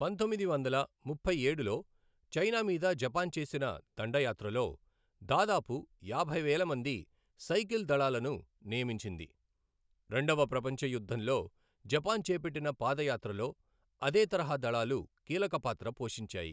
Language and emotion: Telugu, neutral